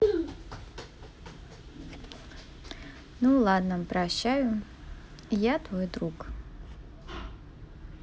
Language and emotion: Russian, neutral